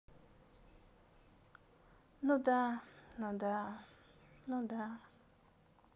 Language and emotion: Russian, sad